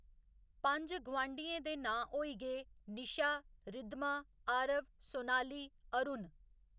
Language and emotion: Dogri, neutral